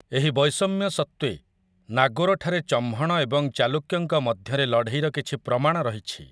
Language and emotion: Odia, neutral